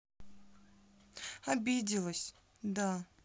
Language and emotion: Russian, sad